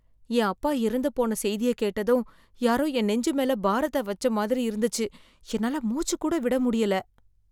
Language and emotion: Tamil, sad